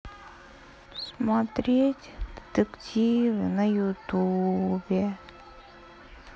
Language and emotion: Russian, sad